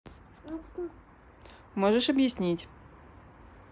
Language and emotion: Russian, neutral